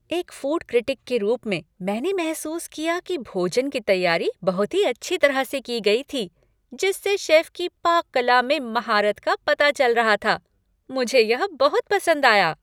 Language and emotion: Hindi, happy